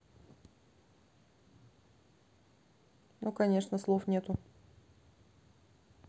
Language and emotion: Russian, neutral